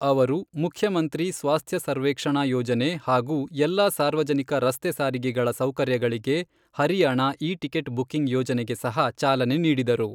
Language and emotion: Kannada, neutral